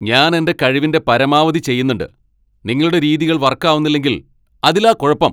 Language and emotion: Malayalam, angry